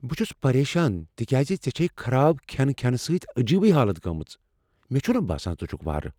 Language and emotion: Kashmiri, fearful